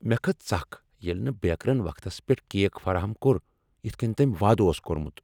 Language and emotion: Kashmiri, angry